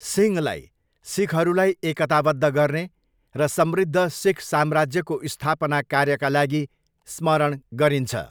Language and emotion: Nepali, neutral